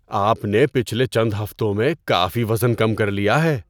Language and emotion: Urdu, surprised